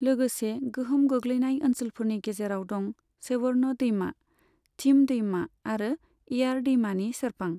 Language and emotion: Bodo, neutral